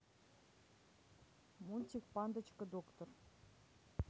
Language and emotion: Russian, neutral